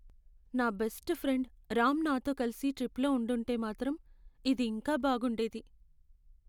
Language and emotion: Telugu, sad